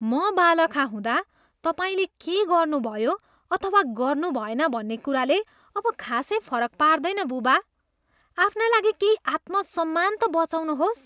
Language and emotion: Nepali, disgusted